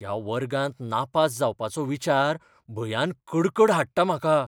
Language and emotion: Goan Konkani, fearful